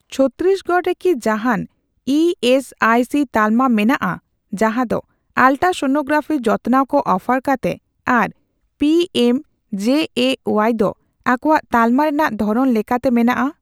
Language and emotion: Santali, neutral